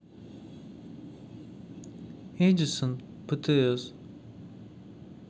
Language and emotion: Russian, neutral